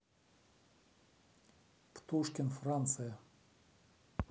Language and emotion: Russian, neutral